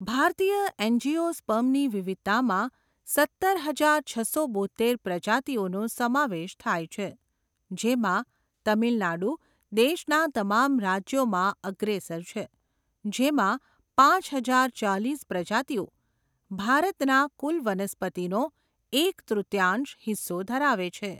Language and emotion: Gujarati, neutral